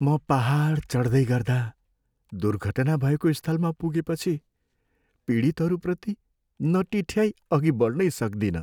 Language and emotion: Nepali, sad